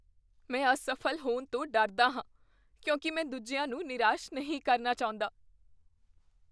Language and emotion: Punjabi, fearful